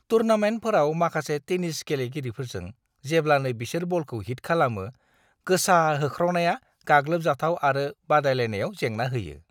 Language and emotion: Bodo, disgusted